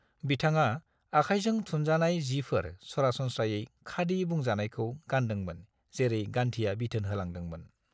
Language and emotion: Bodo, neutral